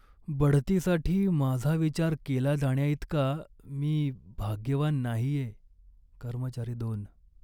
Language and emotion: Marathi, sad